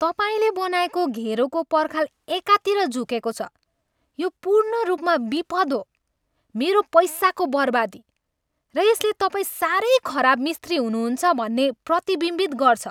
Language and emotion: Nepali, angry